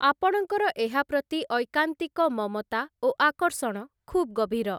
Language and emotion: Odia, neutral